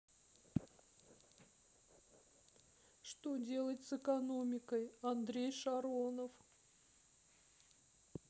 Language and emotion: Russian, sad